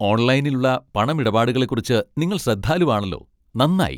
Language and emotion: Malayalam, happy